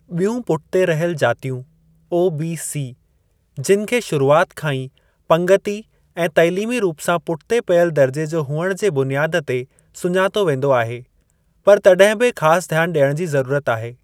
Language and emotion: Sindhi, neutral